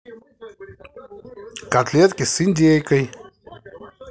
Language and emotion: Russian, positive